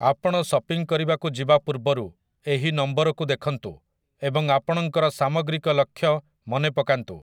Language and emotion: Odia, neutral